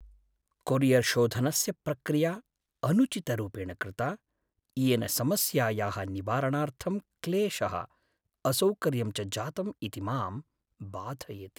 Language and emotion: Sanskrit, sad